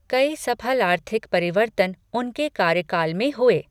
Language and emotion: Hindi, neutral